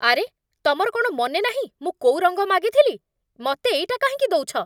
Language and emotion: Odia, angry